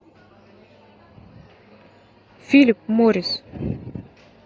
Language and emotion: Russian, neutral